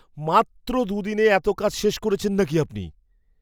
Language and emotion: Bengali, surprised